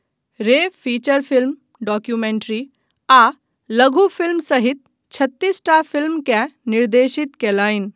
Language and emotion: Maithili, neutral